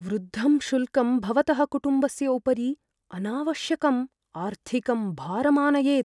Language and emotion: Sanskrit, fearful